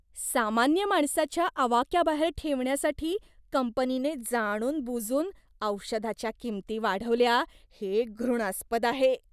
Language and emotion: Marathi, disgusted